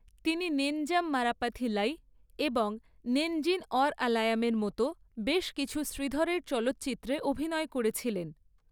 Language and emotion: Bengali, neutral